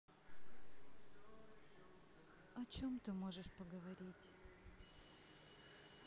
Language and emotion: Russian, sad